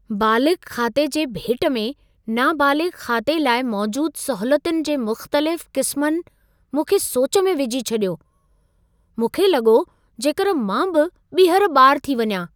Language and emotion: Sindhi, surprised